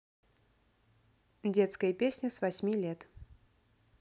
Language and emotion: Russian, neutral